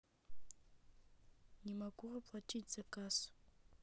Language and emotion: Russian, neutral